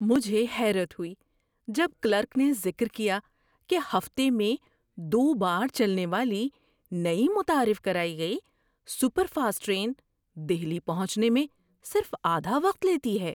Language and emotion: Urdu, surprised